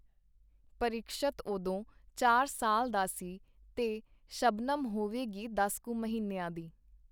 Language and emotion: Punjabi, neutral